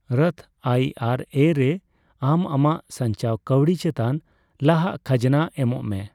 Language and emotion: Santali, neutral